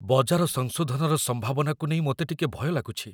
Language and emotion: Odia, fearful